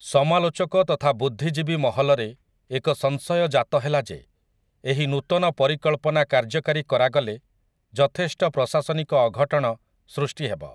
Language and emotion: Odia, neutral